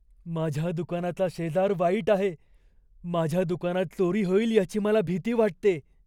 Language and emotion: Marathi, fearful